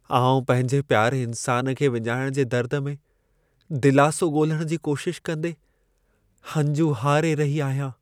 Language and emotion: Sindhi, sad